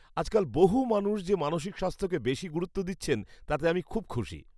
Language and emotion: Bengali, happy